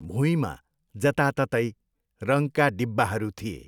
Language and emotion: Nepali, neutral